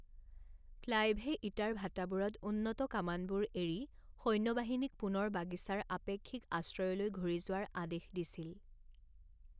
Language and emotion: Assamese, neutral